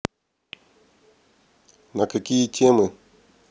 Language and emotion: Russian, neutral